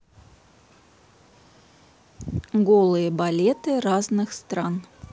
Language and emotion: Russian, neutral